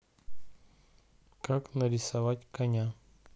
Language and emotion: Russian, neutral